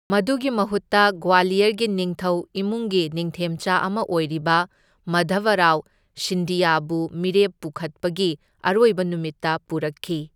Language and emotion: Manipuri, neutral